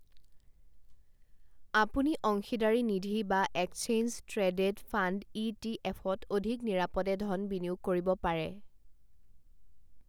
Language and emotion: Assamese, neutral